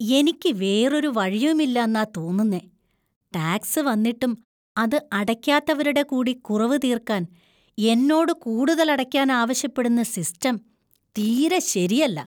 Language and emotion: Malayalam, disgusted